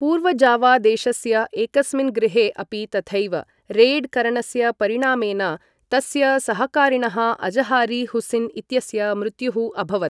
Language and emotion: Sanskrit, neutral